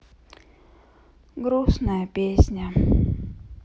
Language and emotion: Russian, sad